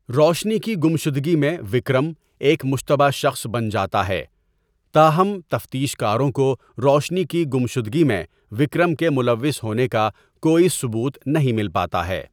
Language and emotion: Urdu, neutral